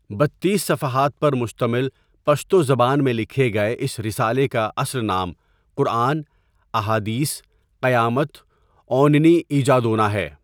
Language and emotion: Urdu, neutral